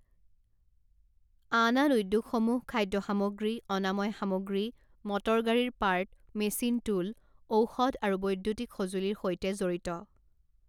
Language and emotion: Assamese, neutral